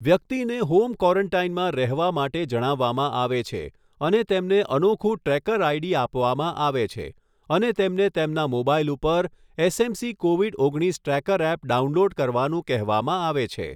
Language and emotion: Gujarati, neutral